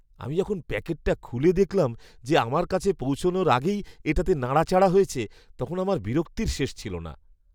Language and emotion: Bengali, disgusted